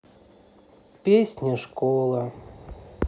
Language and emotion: Russian, sad